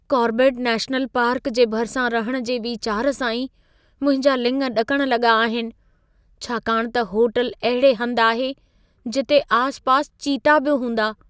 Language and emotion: Sindhi, fearful